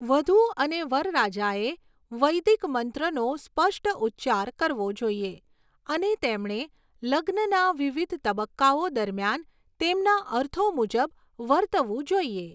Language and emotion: Gujarati, neutral